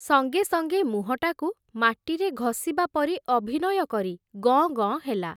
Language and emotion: Odia, neutral